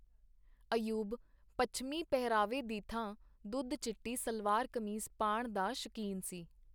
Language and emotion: Punjabi, neutral